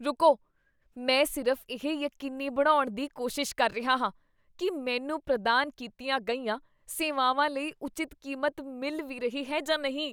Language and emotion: Punjabi, disgusted